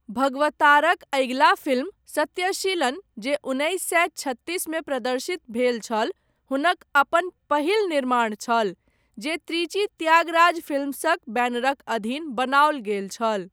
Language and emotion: Maithili, neutral